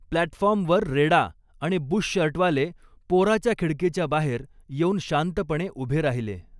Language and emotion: Marathi, neutral